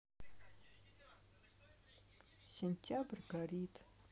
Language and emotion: Russian, sad